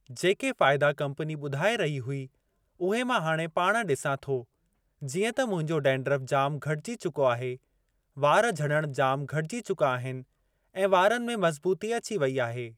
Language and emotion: Sindhi, neutral